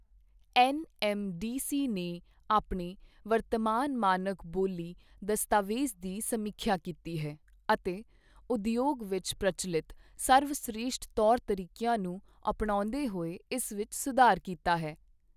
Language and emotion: Punjabi, neutral